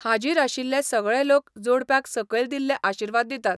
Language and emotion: Goan Konkani, neutral